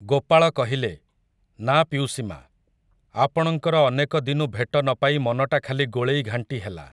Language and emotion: Odia, neutral